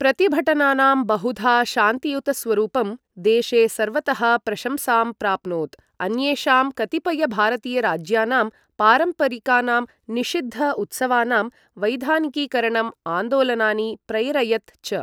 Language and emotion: Sanskrit, neutral